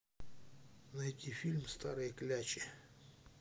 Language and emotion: Russian, neutral